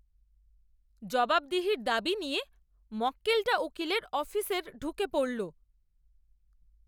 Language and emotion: Bengali, angry